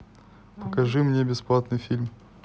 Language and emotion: Russian, neutral